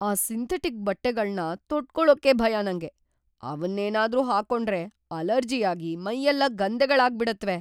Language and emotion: Kannada, fearful